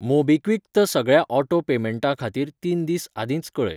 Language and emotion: Goan Konkani, neutral